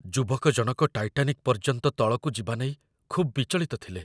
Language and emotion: Odia, fearful